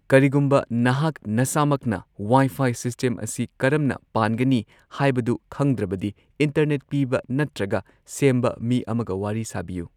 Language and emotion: Manipuri, neutral